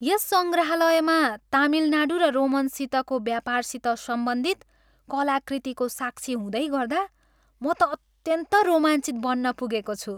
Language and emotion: Nepali, happy